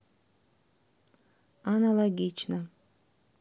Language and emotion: Russian, neutral